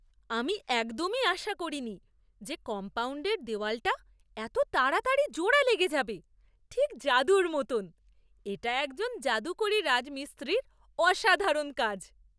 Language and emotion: Bengali, surprised